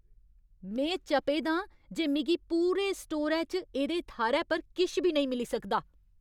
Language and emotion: Dogri, angry